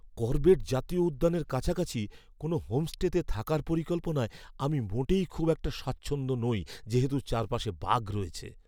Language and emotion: Bengali, fearful